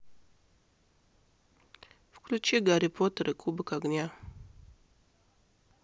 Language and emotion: Russian, neutral